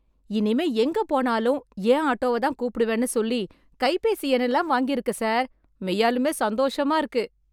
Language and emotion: Tamil, happy